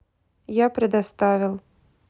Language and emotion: Russian, neutral